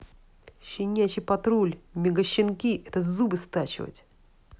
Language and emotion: Russian, angry